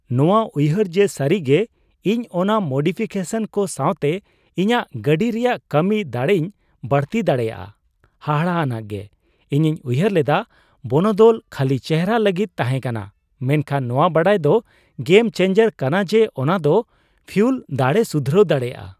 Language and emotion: Santali, surprised